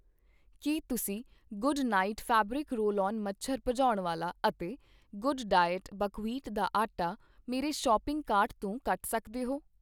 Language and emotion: Punjabi, neutral